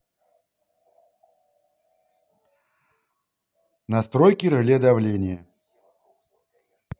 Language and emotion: Russian, neutral